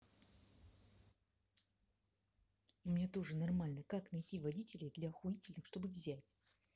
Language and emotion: Russian, angry